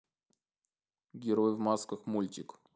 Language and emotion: Russian, neutral